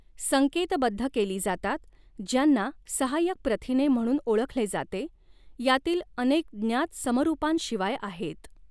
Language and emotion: Marathi, neutral